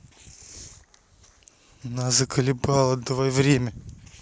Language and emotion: Russian, angry